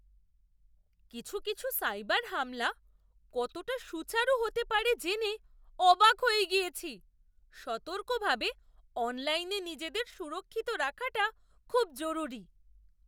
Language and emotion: Bengali, surprised